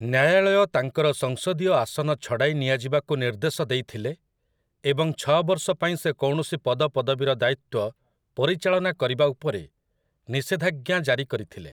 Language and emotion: Odia, neutral